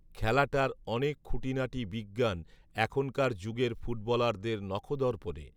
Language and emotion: Bengali, neutral